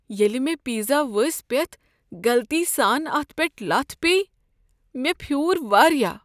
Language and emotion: Kashmiri, sad